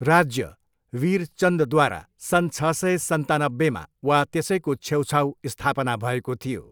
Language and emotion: Nepali, neutral